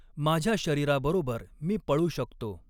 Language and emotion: Marathi, neutral